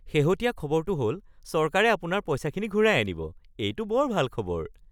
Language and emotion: Assamese, happy